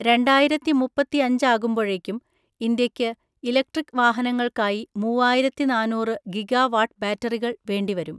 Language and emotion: Malayalam, neutral